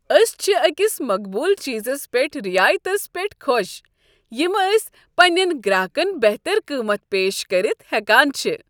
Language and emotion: Kashmiri, happy